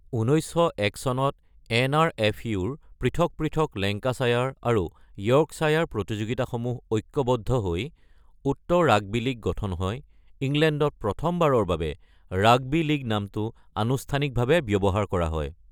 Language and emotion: Assamese, neutral